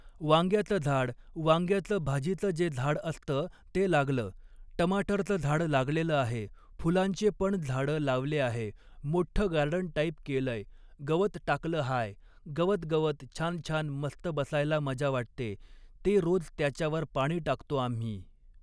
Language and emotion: Marathi, neutral